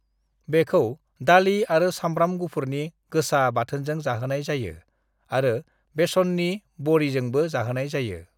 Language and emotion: Bodo, neutral